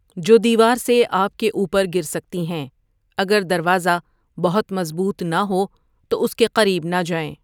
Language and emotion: Urdu, neutral